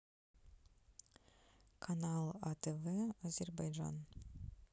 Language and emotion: Russian, neutral